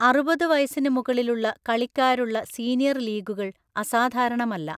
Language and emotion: Malayalam, neutral